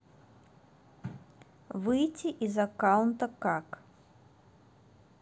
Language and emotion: Russian, neutral